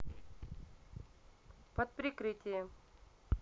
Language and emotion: Russian, neutral